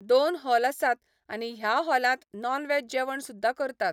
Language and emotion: Goan Konkani, neutral